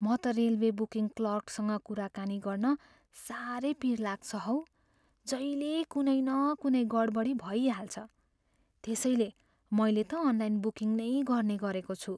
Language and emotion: Nepali, fearful